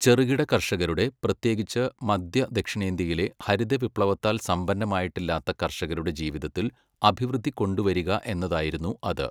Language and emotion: Malayalam, neutral